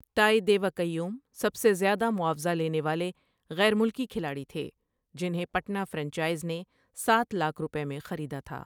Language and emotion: Urdu, neutral